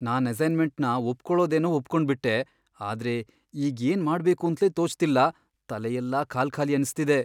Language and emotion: Kannada, fearful